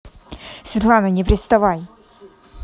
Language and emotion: Russian, angry